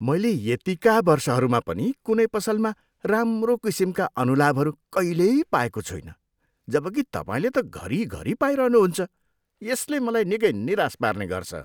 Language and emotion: Nepali, disgusted